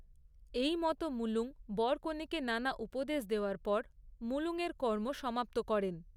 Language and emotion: Bengali, neutral